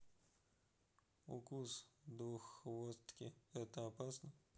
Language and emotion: Russian, neutral